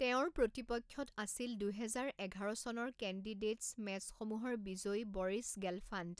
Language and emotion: Assamese, neutral